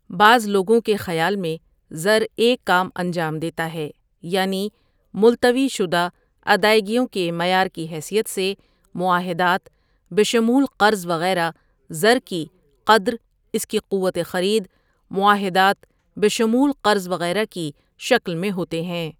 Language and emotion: Urdu, neutral